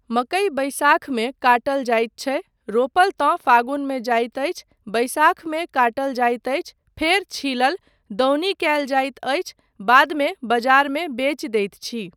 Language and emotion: Maithili, neutral